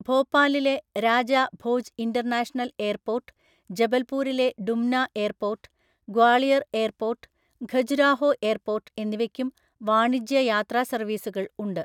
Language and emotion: Malayalam, neutral